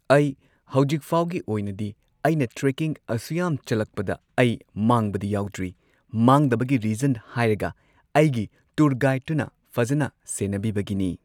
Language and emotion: Manipuri, neutral